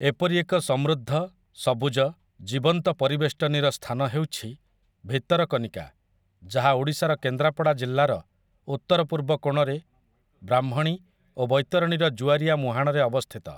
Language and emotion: Odia, neutral